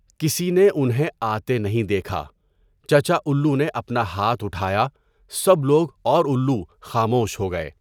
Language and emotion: Urdu, neutral